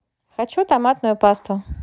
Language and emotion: Russian, positive